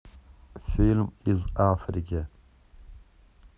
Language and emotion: Russian, neutral